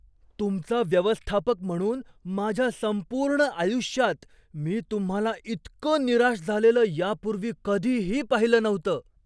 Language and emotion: Marathi, surprised